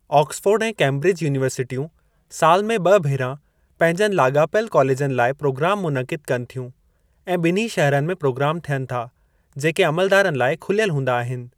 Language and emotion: Sindhi, neutral